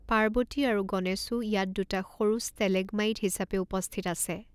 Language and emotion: Assamese, neutral